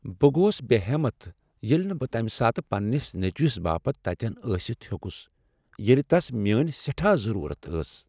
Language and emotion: Kashmiri, sad